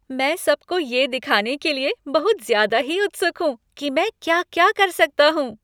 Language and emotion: Hindi, happy